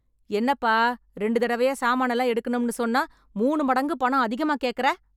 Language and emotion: Tamil, angry